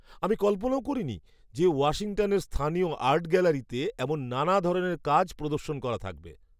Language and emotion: Bengali, surprised